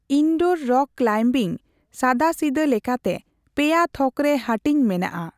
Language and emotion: Santali, neutral